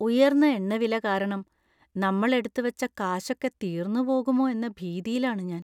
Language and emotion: Malayalam, fearful